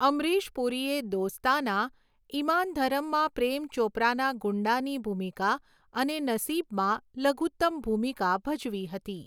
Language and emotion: Gujarati, neutral